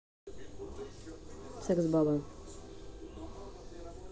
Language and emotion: Russian, neutral